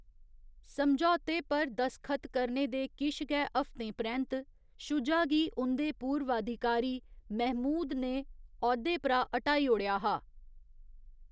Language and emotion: Dogri, neutral